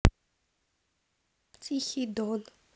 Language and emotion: Russian, neutral